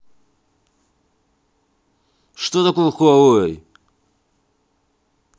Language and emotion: Russian, neutral